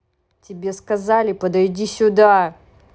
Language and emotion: Russian, angry